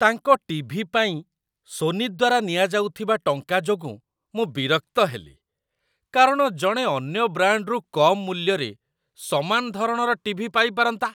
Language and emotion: Odia, disgusted